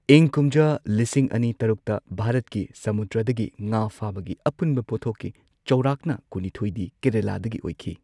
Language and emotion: Manipuri, neutral